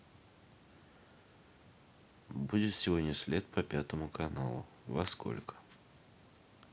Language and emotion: Russian, neutral